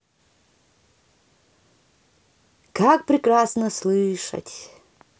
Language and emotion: Russian, positive